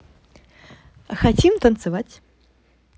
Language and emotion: Russian, positive